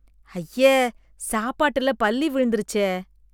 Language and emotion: Tamil, disgusted